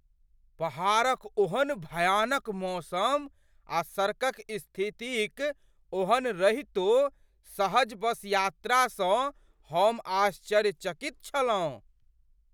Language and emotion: Maithili, surprised